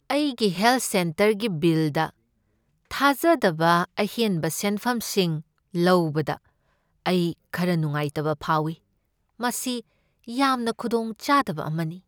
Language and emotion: Manipuri, sad